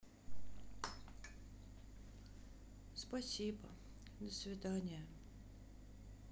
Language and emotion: Russian, sad